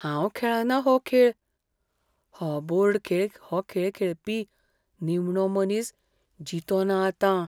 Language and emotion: Goan Konkani, fearful